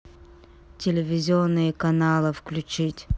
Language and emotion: Russian, neutral